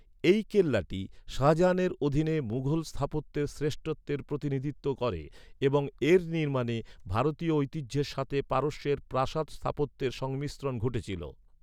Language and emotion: Bengali, neutral